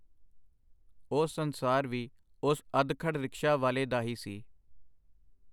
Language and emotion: Punjabi, neutral